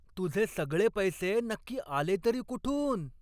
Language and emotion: Marathi, angry